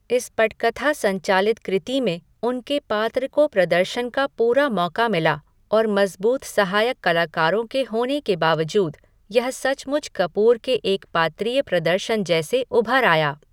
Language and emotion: Hindi, neutral